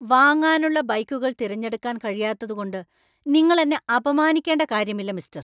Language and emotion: Malayalam, angry